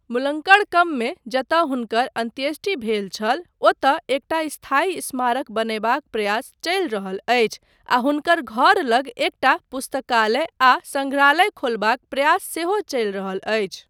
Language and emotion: Maithili, neutral